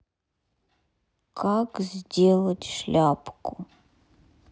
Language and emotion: Russian, neutral